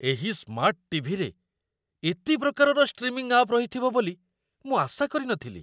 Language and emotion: Odia, surprised